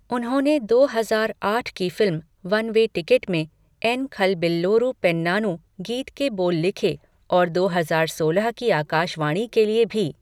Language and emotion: Hindi, neutral